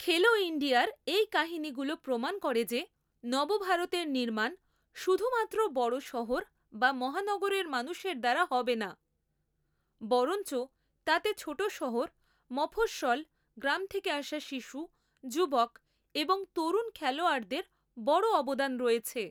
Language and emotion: Bengali, neutral